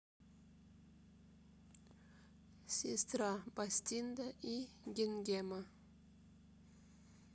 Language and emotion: Russian, sad